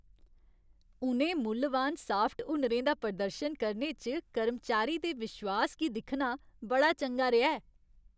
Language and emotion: Dogri, happy